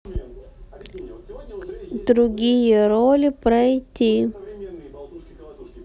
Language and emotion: Russian, neutral